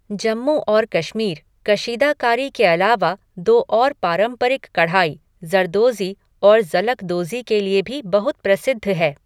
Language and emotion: Hindi, neutral